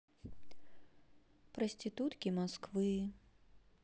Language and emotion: Russian, sad